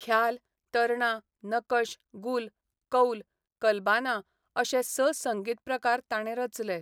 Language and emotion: Goan Konkani, neutral